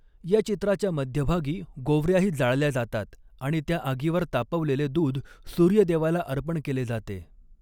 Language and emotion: Marathi, neutral